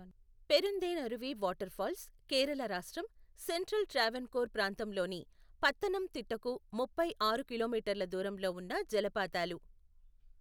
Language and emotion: Telugu, neutral